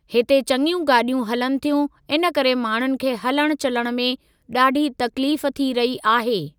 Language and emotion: Sindhi, neutral